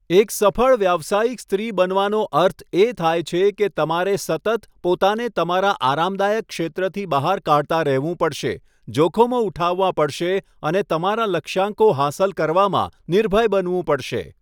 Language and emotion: Gujarati, neutral